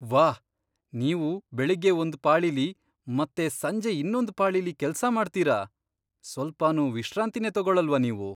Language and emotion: Kannada, surprised